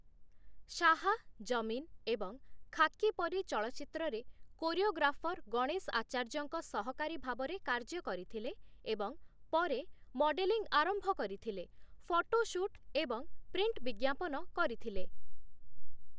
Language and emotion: Odia, neutral